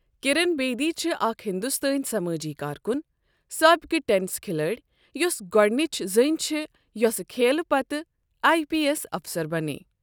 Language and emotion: Kashmiri, neutral